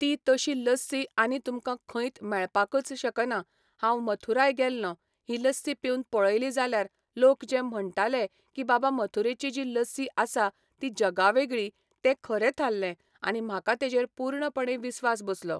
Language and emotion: Goan Konkani, neutral